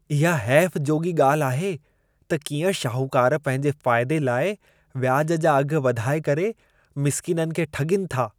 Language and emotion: Sindhi, disgusted